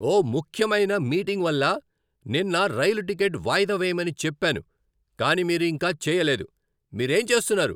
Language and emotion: Telugu, angry